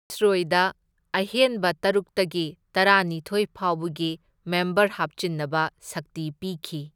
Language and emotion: Manipuri, neutral